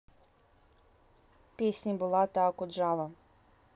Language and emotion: Russian, neutral